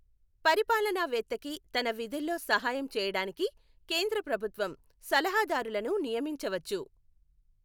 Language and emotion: Telugu, neutral